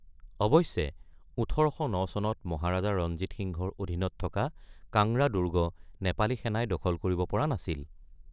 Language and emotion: Assamese, neutral